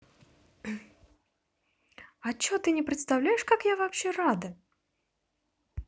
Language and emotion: Russian, positive